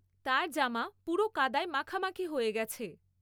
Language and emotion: Bengali, neutral